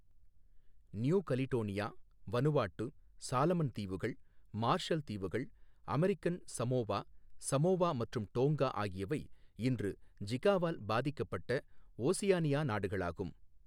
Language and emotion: Tamil, neutral